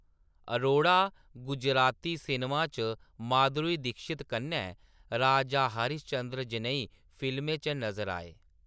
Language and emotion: Dogri, neutral